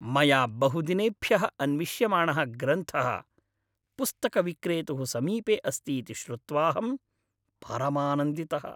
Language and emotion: Sanskrit, happy